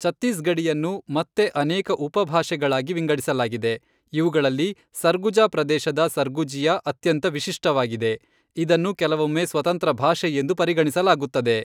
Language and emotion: Kannada, neutral